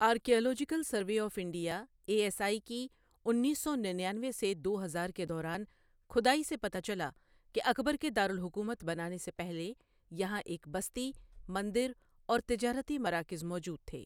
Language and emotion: Urdu, neutral